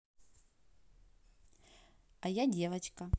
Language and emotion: Russian, positive